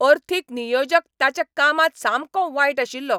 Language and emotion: Goan Konkani, angry